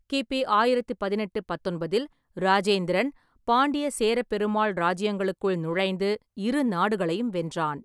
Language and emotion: Tamil, neutral